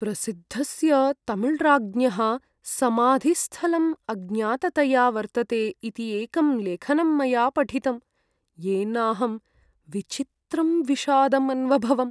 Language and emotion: Sanskrit, sad